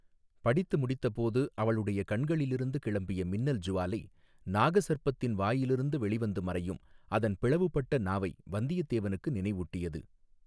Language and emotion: Tamil, neutral